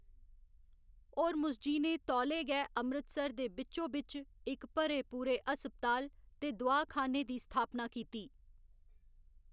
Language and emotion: Dogri, neutral